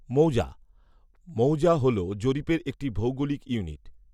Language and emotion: Bengali, neutral